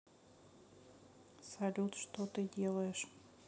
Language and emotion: Russian, sad